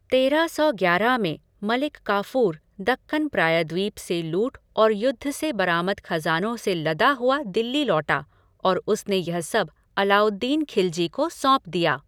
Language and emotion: Hindi, neutral